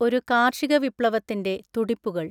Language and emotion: Malayalam, neutral